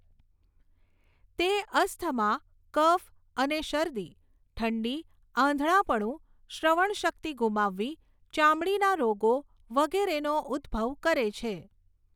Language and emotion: Gujarati, neutral